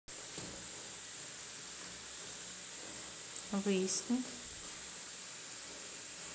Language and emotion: Russian, neutral